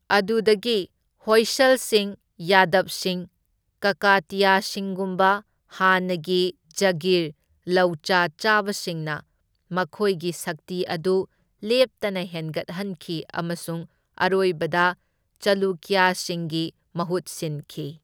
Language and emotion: Manipuri, neutral